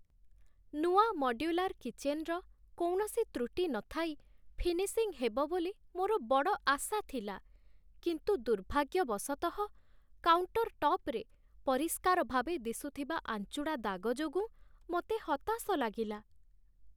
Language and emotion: Odia, sad